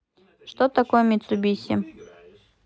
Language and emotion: Russian, neutral